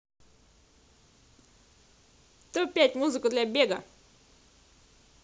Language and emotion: Russian, positive